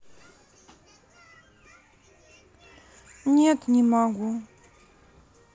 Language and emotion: Russian, sad